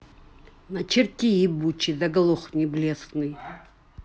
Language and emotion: Russian, angry